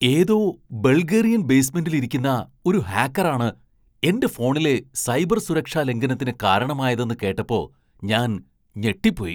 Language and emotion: Malayalam, surprised